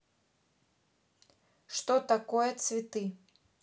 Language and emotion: Russian, neutral